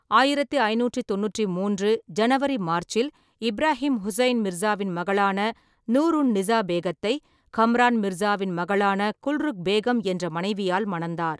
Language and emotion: Tamil, neutral